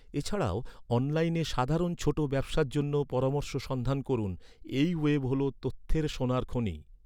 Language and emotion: Bengali, neutral